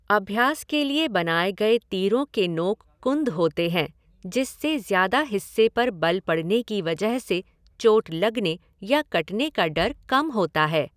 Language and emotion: Hindi, neutral